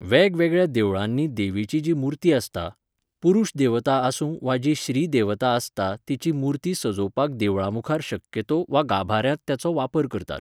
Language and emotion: Goan Konkani, neutral